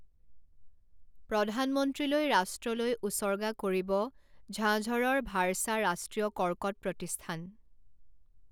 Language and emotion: Assamese, neutral